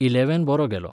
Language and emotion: Goan Konkani, neutral